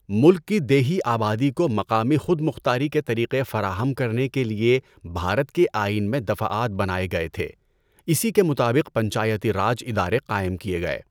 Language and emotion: Urdu, neutral